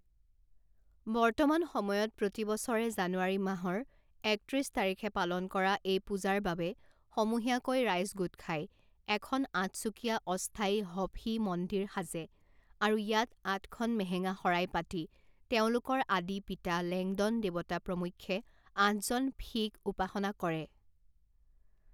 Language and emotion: Assamese, neutral